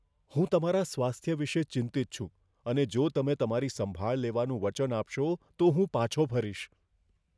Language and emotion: Gujarati, fearful